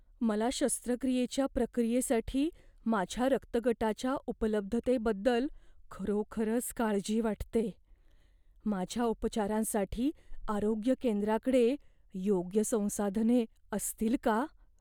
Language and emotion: Marathi, fearful